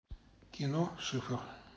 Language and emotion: Russian, neutral